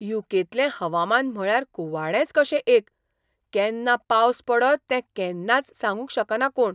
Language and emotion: Goan Konkani, surprised